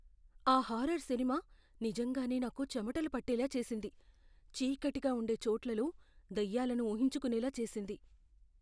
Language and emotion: Telugu, fearful